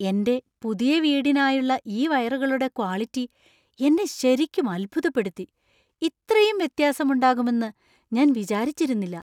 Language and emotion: Malayalam, surprised